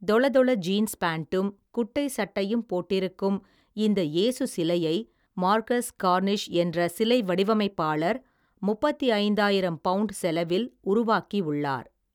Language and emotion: Tamil, neutral